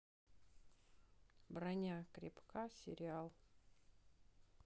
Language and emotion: Russian, neutral